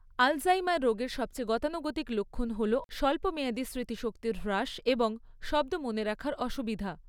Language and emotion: Bengali, neutral